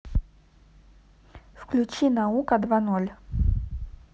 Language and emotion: Russian, neutral